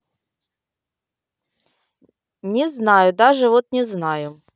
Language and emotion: Russian, angry